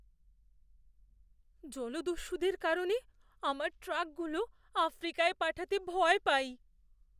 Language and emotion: Bengali, fearful